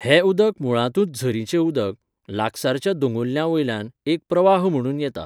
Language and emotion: Goan Konkani, neutral